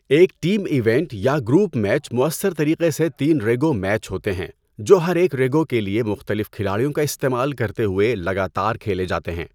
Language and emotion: Urdu, neutral